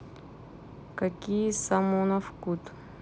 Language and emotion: Russian, neutral